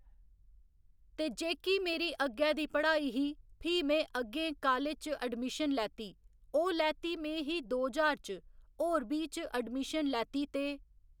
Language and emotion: Dogri, neutral